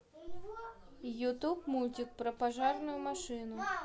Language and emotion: Russian, neutral